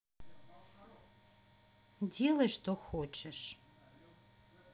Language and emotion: Russian, angry